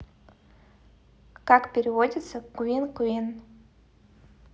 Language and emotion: Russian, neutral